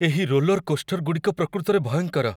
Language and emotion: Odia, fearful